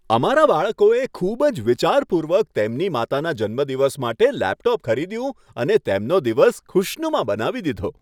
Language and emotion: Gujarati, happy